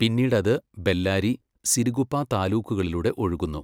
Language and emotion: Malayalam, neutral